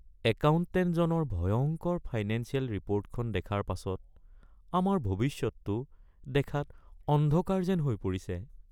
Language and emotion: Assamese, sad